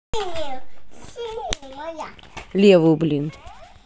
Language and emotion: Russian, angry